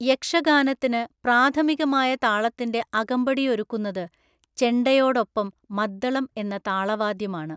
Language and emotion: Malayalam, neutral